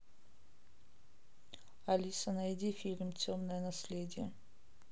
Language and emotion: Russian, neutral